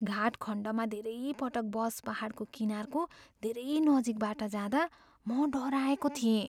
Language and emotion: Nepali, fearful